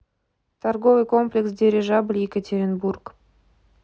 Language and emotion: Russian, neutral